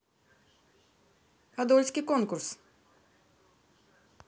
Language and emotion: Russian, neutral